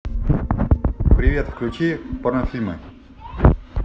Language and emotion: Russian, positive